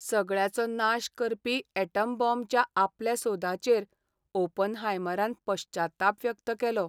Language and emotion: Goan Konkani, sad